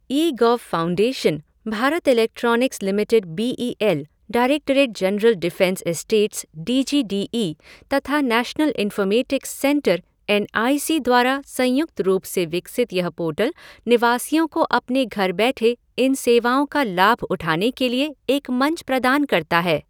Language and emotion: Hindi, neutral